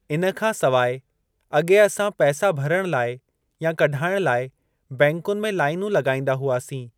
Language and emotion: Sindhi, neutral